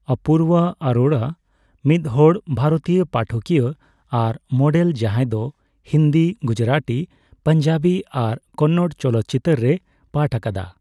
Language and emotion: Santali, neutral